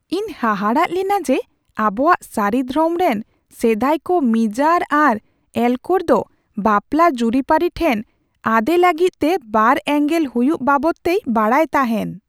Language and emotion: Santali, surprised